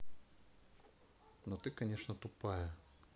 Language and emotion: Russian, neutral